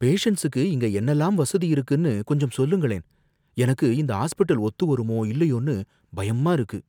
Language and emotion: Tamil, fearful